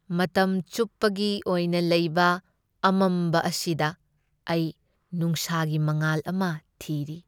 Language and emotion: Manipuri, sad